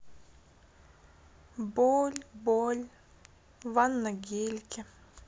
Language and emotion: Russian, sad